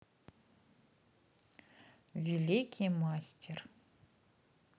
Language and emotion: Russian, neutral